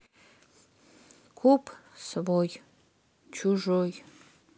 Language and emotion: Russian, neutral